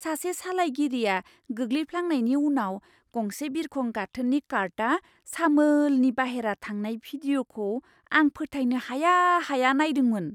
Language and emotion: Bodo, surprised